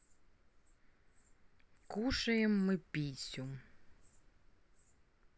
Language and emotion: Russian, neutral